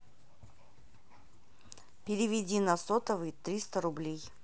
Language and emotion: Russian, neutral